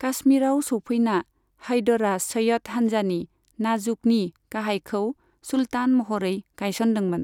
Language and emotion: Bodo, neutral